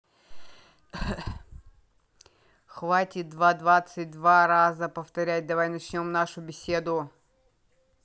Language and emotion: Russian, neutral